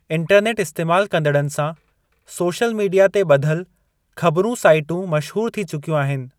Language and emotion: Sindhi, neutral